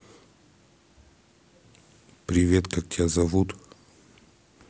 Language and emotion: Russian, neutral